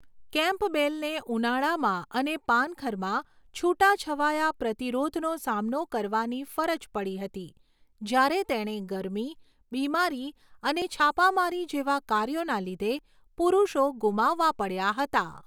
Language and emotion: Gujarati, neutral